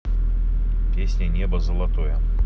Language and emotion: Russian, neutral